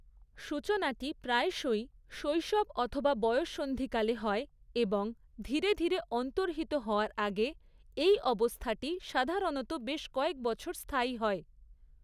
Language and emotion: Bengali, neutral